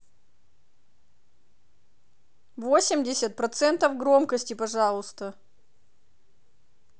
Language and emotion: Russian, angry